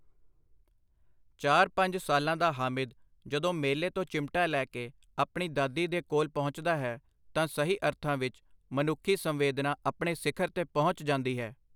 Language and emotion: Punjabi, neutral